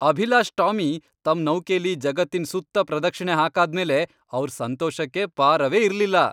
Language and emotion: Kannada, happy